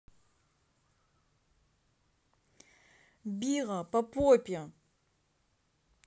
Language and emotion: Russian, neutral